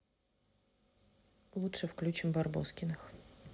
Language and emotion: Russian, neutral